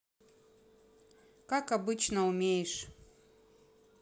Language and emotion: Russian, neutral